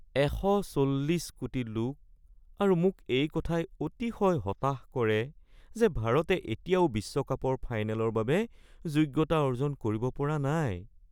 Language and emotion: Assamese, sad